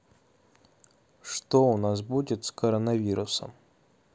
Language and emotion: Russian, neutral